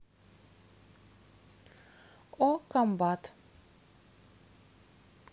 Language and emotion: Russian, neutral